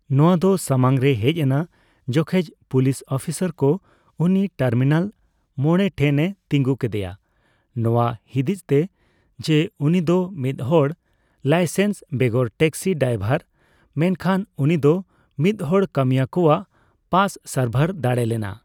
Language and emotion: Santali, neutral